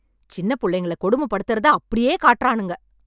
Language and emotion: Tamil, angry